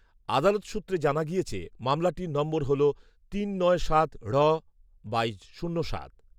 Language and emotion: Bengali, neutral